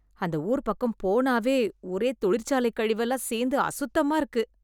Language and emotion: Tamil, disgusted